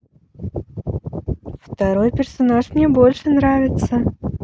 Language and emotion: Russian, positive